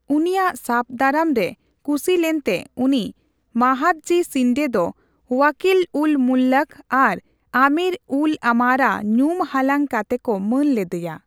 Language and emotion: Santali, neutral